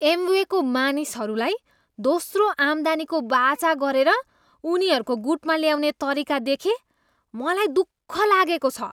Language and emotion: Nepali, disgusted